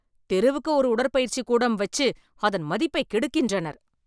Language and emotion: Tamil, angry